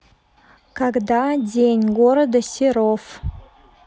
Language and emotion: Russian, neutral